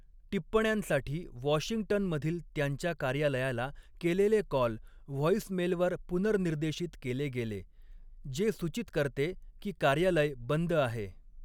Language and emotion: Marathi, neutral